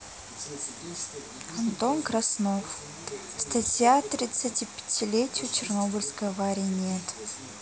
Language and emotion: Russian, neutral